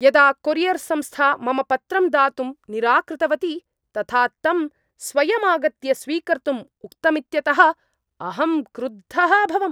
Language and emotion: Sanskrit, angry